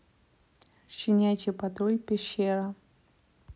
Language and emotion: Russian, neutral